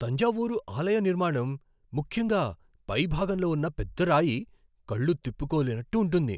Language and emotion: Telugu, surprised